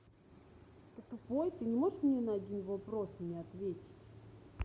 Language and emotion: Russian, angry